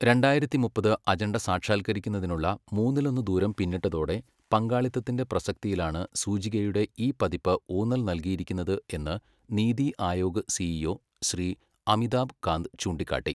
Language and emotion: Malayalam, neutral